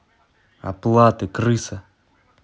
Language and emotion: Russian, angry